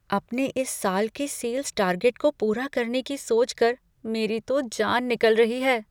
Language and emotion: Hindi, fearful